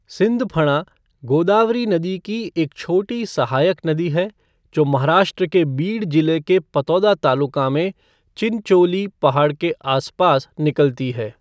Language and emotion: Hindi, neutral